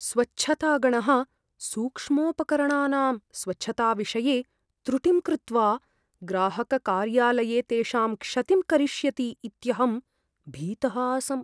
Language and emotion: Sanskrit, fearful